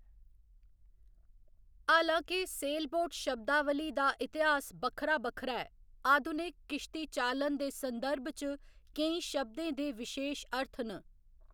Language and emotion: Dogri, neutral